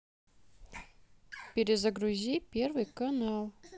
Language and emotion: Russian, neutral